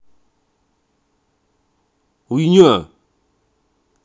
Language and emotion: Russian, angry